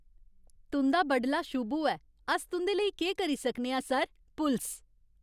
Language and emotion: Dogri, happy